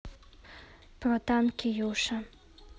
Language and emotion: Russian, neutral